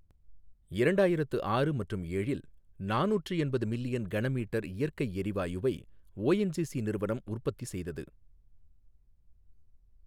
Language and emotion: Tamil, neutral